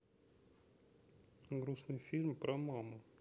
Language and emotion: Russian, neutral